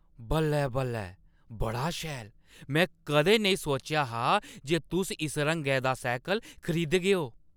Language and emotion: Dogri, surprised